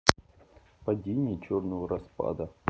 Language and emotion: Russian, neutral